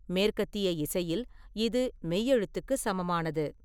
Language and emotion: Tamil, neutral